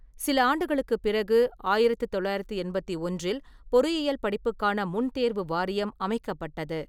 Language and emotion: Tamil, neutral